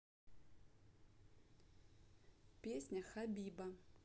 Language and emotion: Russian, neutral